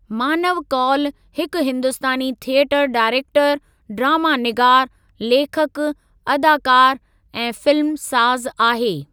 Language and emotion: Sindhi, neutral